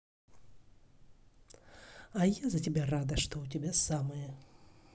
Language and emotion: Russian, neutral